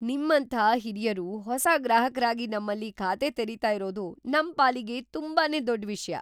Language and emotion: Kannada, surprised